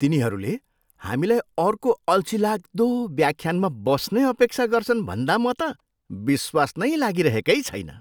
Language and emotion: Nepali, disgusted